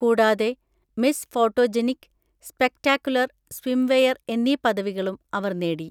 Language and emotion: Malayalam, neutral